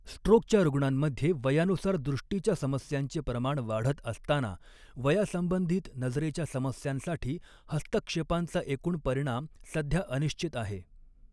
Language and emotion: Marathi, neutral